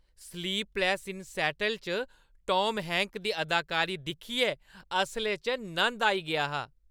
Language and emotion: Dogri, happy